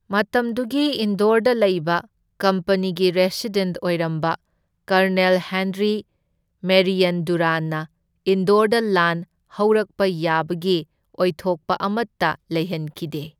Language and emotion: Manipuri, neutral